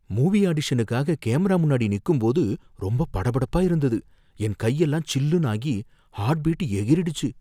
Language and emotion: Tamil, fearful